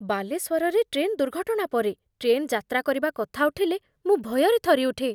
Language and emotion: Odia, fearful